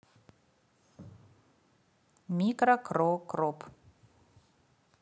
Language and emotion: Russian, neutral